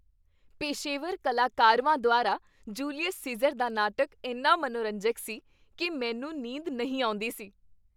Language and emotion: Punjabi, happy